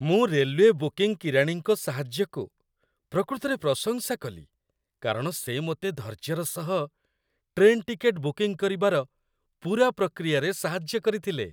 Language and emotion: Odia, happy